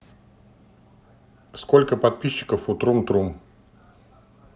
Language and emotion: Russian, neutral